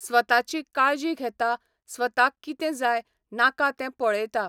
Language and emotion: Goan Konkani, neutral